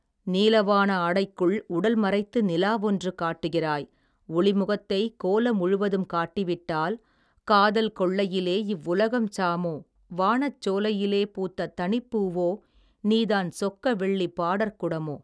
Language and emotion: Tamil, neutral